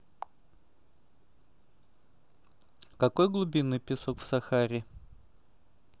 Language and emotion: Russian, neutral